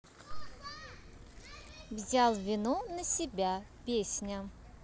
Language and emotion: Russian, positive